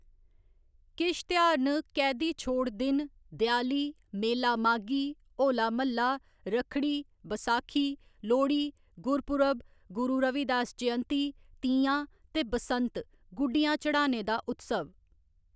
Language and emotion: Dogri, neutral